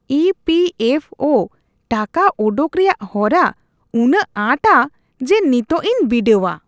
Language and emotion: Santali, disgusted